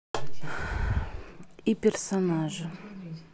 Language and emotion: Russian, sad